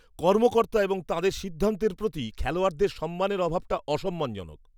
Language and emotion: Bengali, disgusted